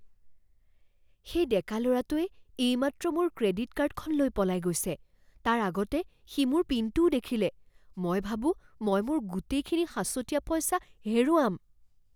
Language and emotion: Assamese, fearful